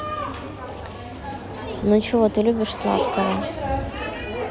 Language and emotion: Russian, neutral